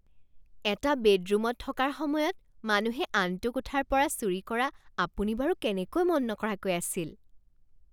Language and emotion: Assamese, surprised